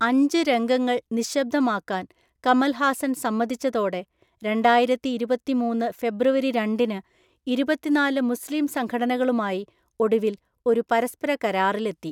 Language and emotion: Malayalam, neutral